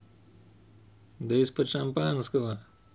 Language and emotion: Russian, neutral